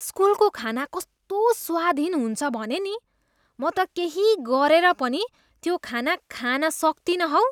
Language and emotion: Nepali, disgusted